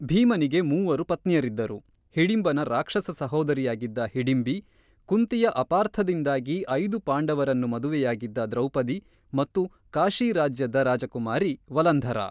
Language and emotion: Kannada, neutral